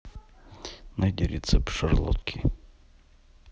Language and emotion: Russian, neutral